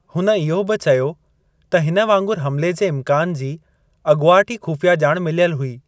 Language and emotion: Sindhi, neutral